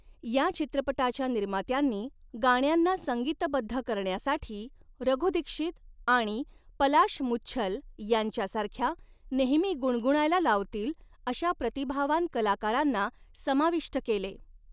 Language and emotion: Marathi, neutral